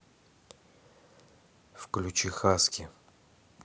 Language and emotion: Russian, neutral